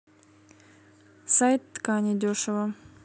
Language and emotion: Russian, neutral